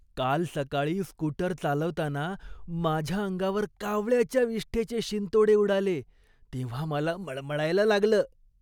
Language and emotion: Marathi, disgusted